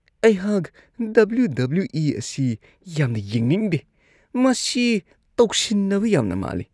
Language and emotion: Manipuri, disgusted